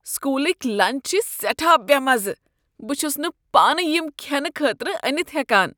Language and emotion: Kashmiri, disgusted